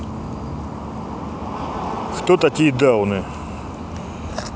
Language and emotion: Russian, neutral